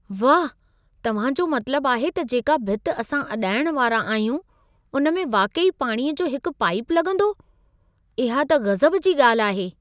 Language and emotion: Sindhi, surprised